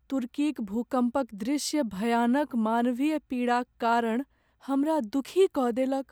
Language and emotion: Maithili, sad